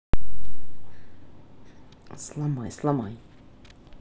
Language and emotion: Russian, neutral